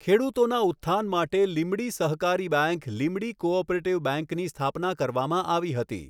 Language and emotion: Gujarati, neutral